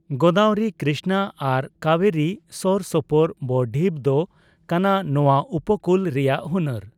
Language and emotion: Santali, neutral